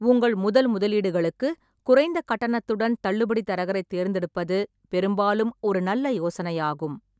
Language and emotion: Tamil, neutral